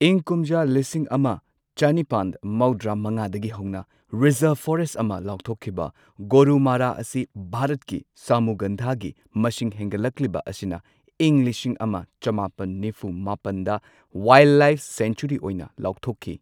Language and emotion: Manipuri, neutral